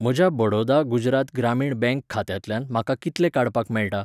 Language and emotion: Goan Konkani, neutral